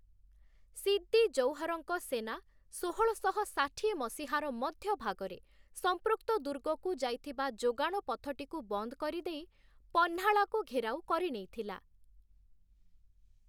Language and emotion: Odia, neutral